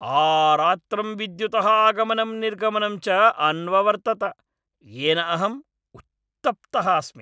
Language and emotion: Sanskrit, angry